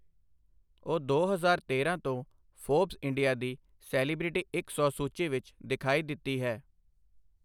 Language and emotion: Punjabi, neutral